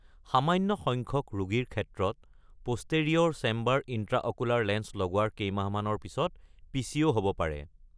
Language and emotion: Assamese, neutral